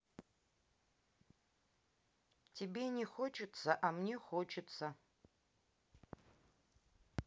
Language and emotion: Russian, neutral